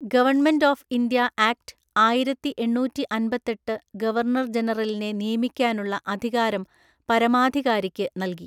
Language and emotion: Malayalam, neutral